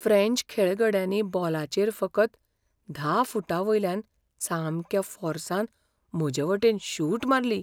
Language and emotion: Goan Konkani, fearful